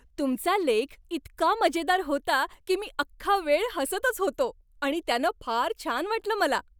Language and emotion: Marathi, happy